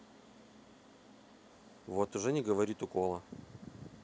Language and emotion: Russian, neutral